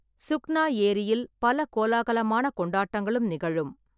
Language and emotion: Tamil, neutral